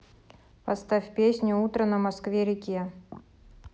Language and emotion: Russian, neutral